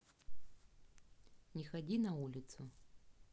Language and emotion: Russian, neutral